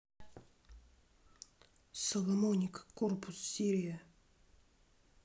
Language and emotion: Russian, neutral